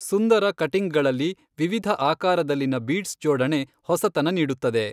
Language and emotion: Kannada, neutral